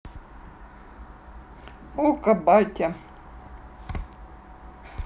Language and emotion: Russian, neutral